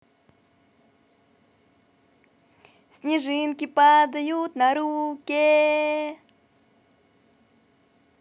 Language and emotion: Russian, positive